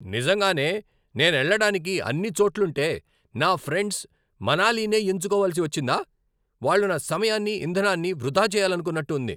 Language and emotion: Telugu, angry